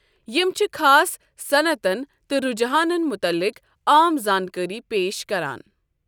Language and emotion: Kashmiri, neutral